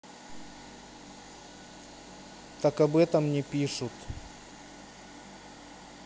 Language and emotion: Russian, neutral